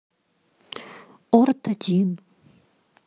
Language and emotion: Russian, neutral